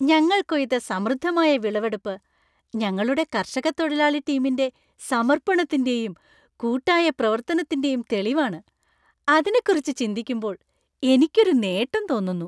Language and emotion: Malayalam, happy